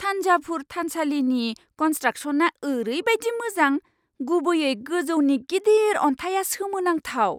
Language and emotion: Bodo, surprised